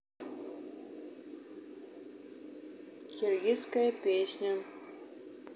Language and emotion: Russian, neutral